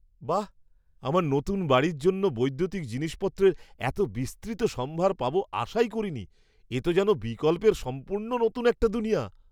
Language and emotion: Bengali, surprised